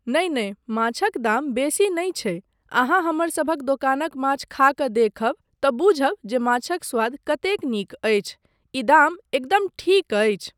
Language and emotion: Maithili, neutral